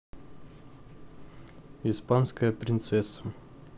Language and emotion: Russian, neutral